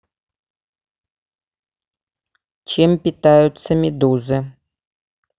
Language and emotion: Russian, neutral